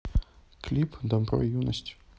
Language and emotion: Russian, neutral